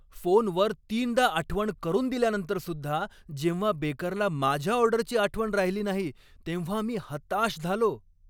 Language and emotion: Marathi, angry